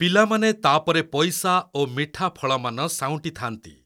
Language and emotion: Odia, neutral